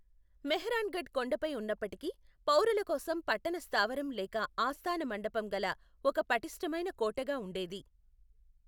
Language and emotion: Telugu, neutral